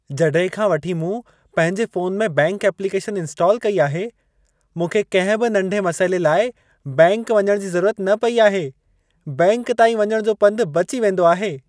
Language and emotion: Sindhi, happy